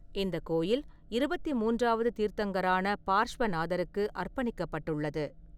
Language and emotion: Tamil, neutral